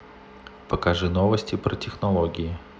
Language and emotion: Russian, neutral